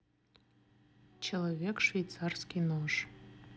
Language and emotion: Russian, neutral